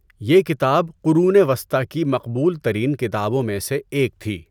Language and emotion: Urdu, neutral